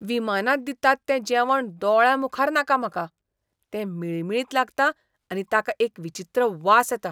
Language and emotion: Goan Konkani, disgusted